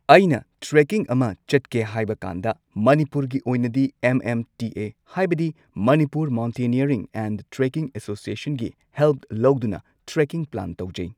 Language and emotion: Manipuri, neutral